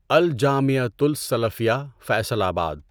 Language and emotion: Urdu, neutral